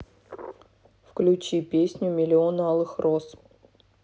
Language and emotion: Russian, neutral